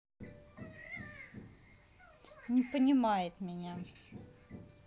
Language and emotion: Russian, neutral